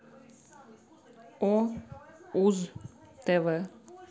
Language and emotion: Russian, neutral